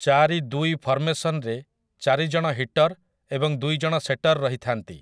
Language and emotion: Odia, neutral